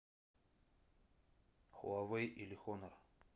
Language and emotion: Russian, neutral